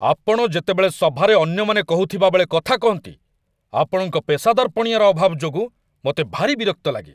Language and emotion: Odia, angry